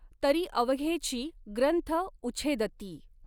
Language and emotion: Marathi, neutral